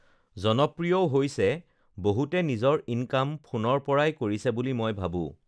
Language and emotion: Assamese, neutral